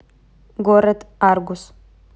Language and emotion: Russian, neutral